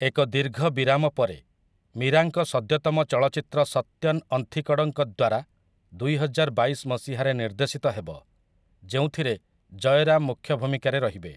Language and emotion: Odia, neutral